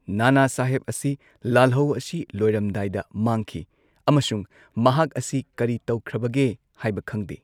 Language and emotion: Manipuri, neutral